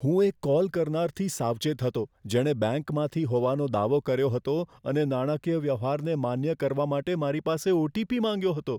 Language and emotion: Gujarati, fearful